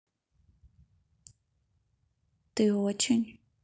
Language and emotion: Russian, neutral